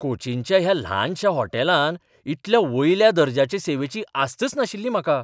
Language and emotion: Goan Konkani, surprised